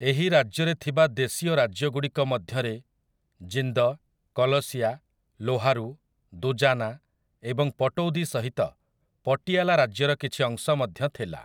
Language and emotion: Odia, neutral